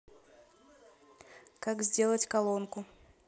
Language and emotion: Russian, neutral